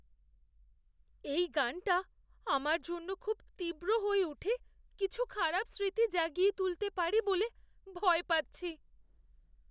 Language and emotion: Bengali, fearful